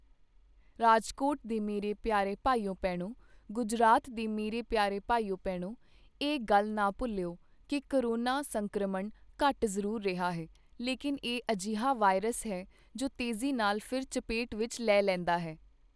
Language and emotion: Punjabi, neutral